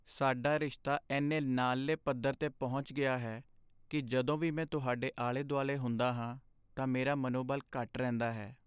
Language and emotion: Punjabi, sad